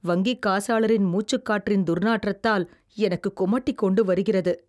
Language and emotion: Tamil, disgusted